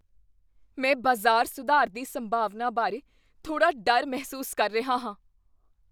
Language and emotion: Punjabi, fearful